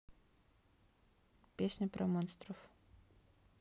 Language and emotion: Russian, neutral